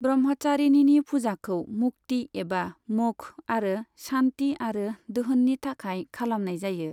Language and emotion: Bodo, neutral